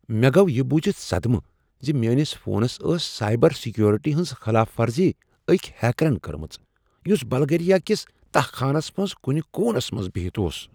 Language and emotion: Kashmiri, surprised